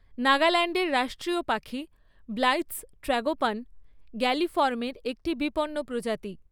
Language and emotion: Bengali, neutral